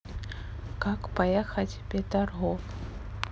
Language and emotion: Russian, neutral